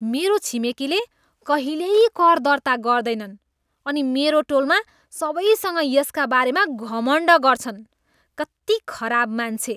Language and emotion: Nepali, disgusted